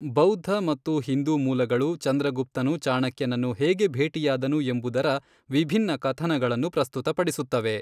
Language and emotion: Kannada, neutral